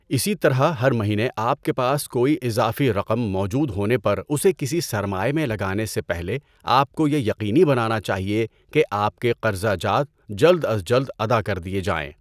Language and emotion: Urdu, neutral